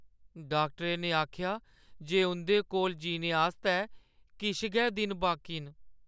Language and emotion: Dogri, sad